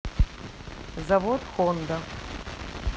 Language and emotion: Russian, neutral